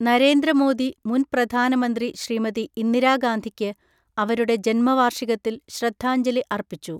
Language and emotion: Malayalam, neutral